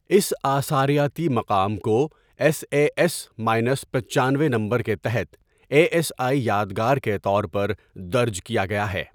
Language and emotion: Urdu, neutral